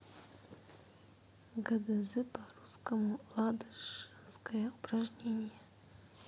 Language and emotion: Russian, neutral